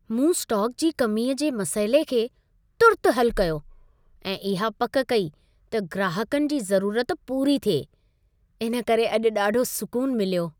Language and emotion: Sindhi, happy